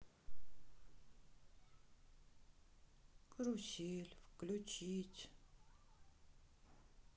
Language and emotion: Russian, sad